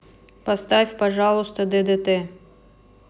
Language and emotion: Russian, neutral